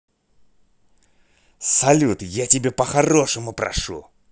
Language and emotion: Russian, angry